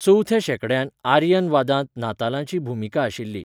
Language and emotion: Goan Konkani, neutral